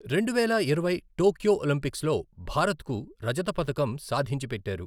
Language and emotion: Telugu, neutral